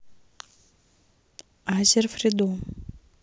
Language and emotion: Russian, neutral